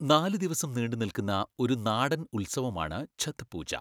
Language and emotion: Malayalam, neutral